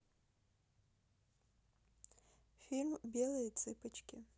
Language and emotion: Russian, neutral